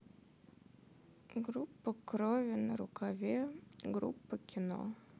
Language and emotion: Russian, sad